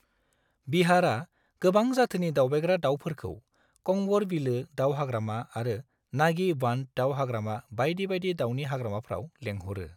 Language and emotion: Bodo, neutral